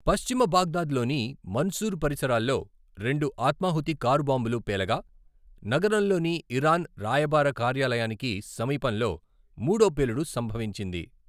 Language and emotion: Telugu, neutral